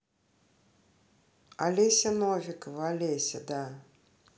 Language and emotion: Russian, neutral